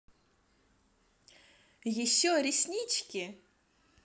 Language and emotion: Russian, positive